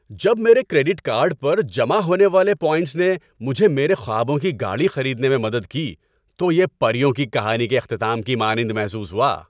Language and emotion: Urdu, happy